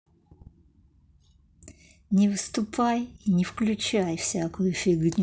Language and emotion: Russian, angry